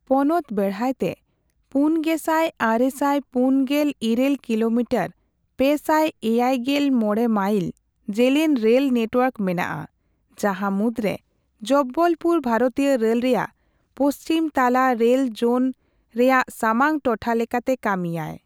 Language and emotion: Santali, neutral